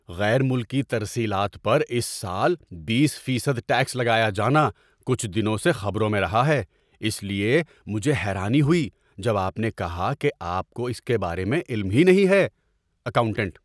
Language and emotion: Urdu, surprised